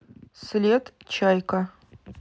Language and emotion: Russian, neutral